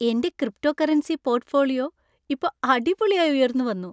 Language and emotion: Malayalam, happy